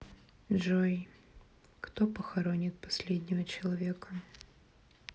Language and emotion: Russian, sad